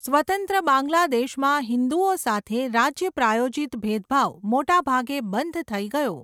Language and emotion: Gujarati, neutral